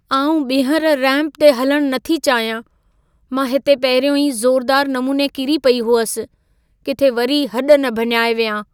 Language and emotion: Sindhi, fearful